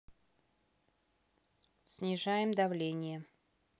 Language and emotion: Russian, neutral